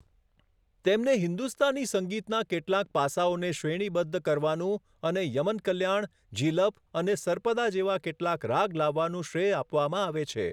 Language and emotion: Gujarati, neutral